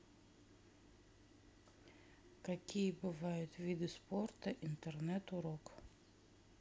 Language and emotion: Russian, neutral